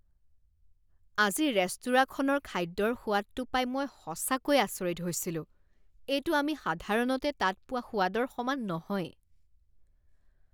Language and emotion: Assamese, disgusted